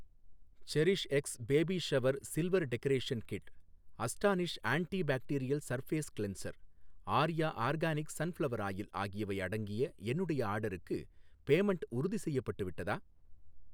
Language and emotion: Tamil, neutral